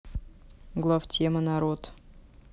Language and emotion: Russian, neutral